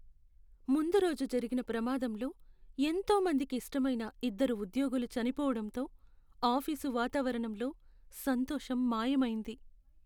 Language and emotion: Telugu, sad